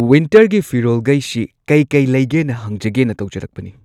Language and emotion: Manipuri, neutral